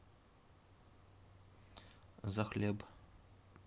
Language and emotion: Russian, neutral